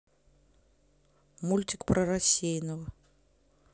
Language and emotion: Russian, neutral